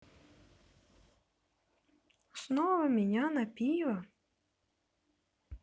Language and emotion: Russian, neutral